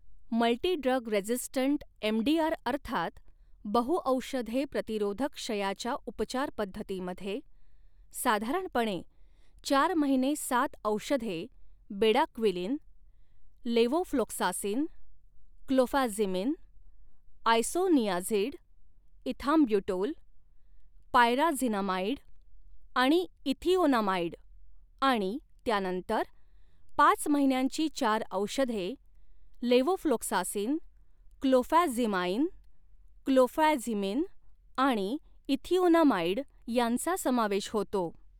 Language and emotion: Marathi, neutral